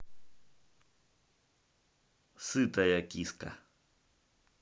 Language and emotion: Russian, neutral